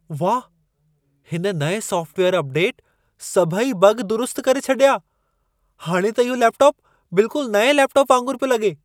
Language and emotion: Sindhi, surprised